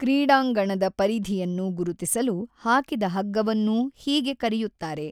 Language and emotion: Kannada, neutral